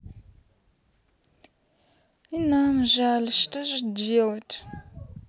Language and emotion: Russian, sad